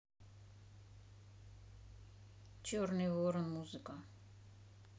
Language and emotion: Russian, neutral